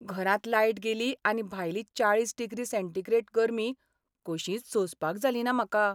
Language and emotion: Goan Konkani, sad